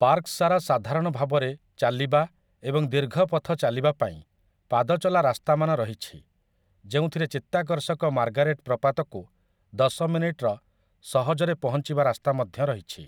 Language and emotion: Odia, neutral